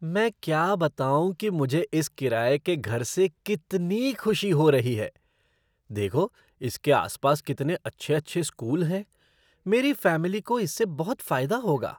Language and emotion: Hindi, surprised